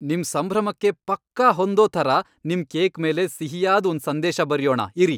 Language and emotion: Kannada, happy